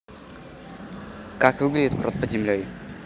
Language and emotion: Russian, neutral